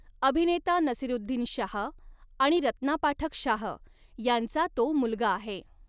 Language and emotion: Marathi, neutral